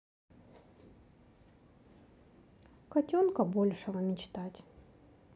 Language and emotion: Russian, sad